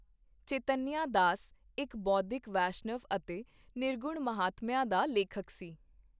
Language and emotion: Punjabi, neutral